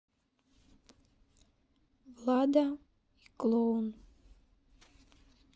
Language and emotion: Russian, sad